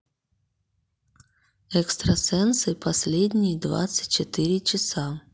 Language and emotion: Russian, neutral